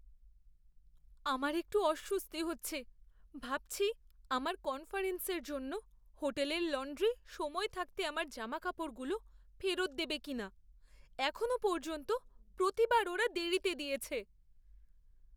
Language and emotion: Bengali, fearful